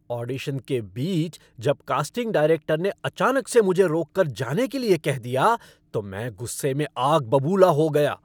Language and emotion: Hindi, angry